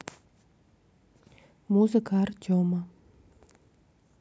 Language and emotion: Russian, neutral